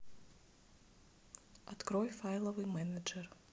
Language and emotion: Russian, neutral